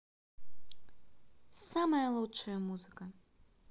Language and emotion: Russian, positive